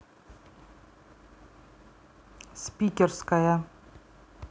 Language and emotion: Russian, neutral